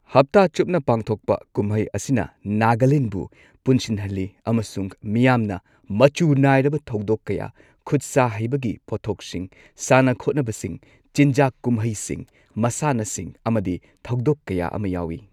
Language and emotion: Manipuri, neutral